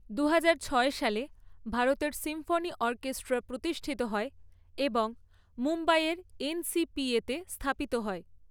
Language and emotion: Bengali, neutral